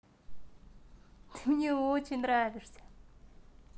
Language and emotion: Russian, positive